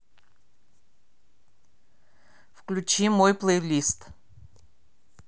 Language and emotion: Russian, neutral